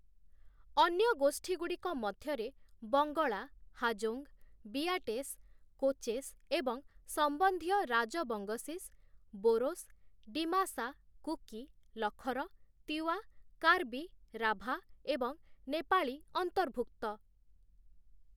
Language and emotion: Odia, neutral